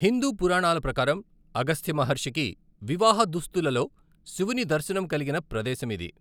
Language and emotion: Telugu, neutral